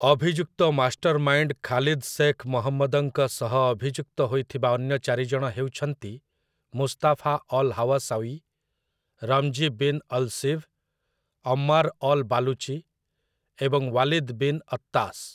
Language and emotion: Odia, neutral